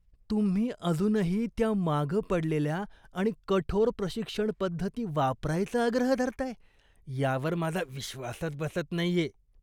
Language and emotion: Marathi, disgusted